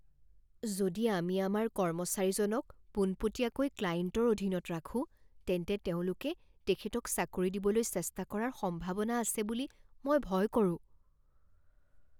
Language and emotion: Assamese, fearful